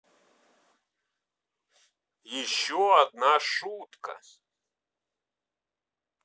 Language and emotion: Russian, neutral